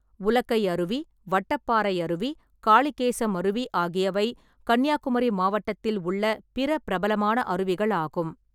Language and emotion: Tamil, neutral